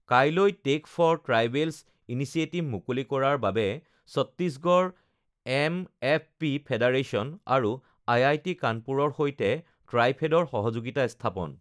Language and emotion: Assamese, neutral